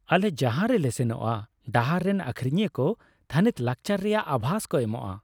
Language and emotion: Santali, happy